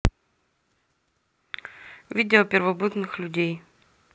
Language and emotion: Russian, neutral